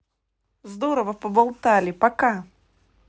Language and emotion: Russian, positive